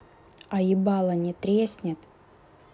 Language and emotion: Russian, angry